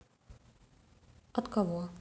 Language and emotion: Russian, neutral